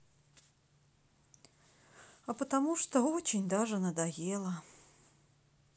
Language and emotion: Russian, sad